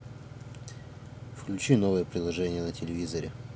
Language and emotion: Russian, neutral